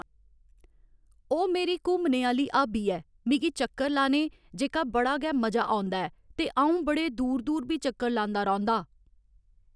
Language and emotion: Dogri, neutral